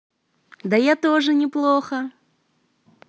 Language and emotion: Russian, positive